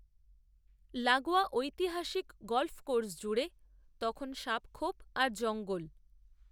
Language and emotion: Bengali, neutral